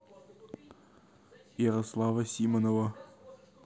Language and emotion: Russian, neutral